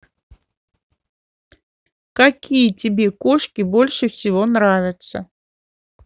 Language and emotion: Russian, neutral